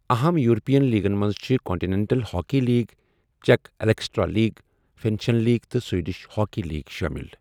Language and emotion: Kashmiri, neutral